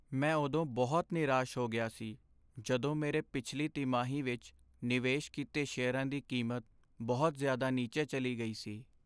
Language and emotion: Punjabi, sad